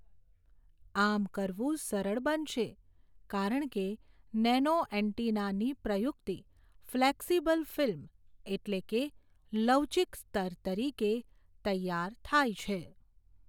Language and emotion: Gujarati, neutral